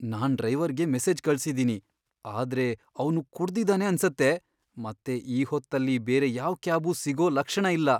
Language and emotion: Kannada, fearful